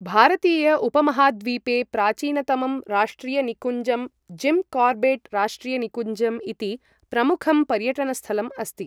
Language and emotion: Sanskrit, neutral